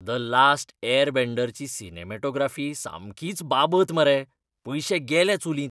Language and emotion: Goan Konkani, disgusted